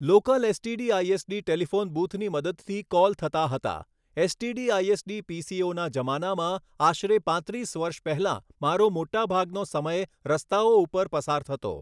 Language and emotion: Gujarati, neutral